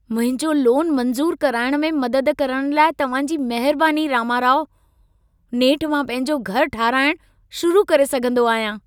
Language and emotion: Sindhi, happy